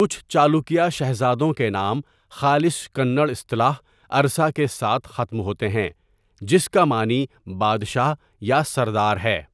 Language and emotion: Urdu, neutral